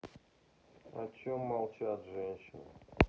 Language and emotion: Russian, sad